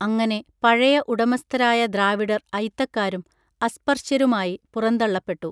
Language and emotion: Malayalam, neutral